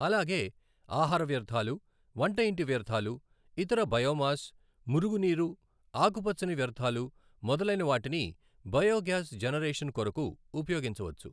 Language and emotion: Telugu, neutral